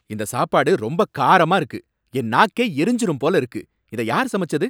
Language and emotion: Tamil, angry